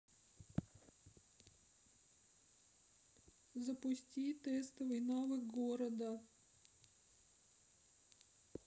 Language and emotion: Russian, sad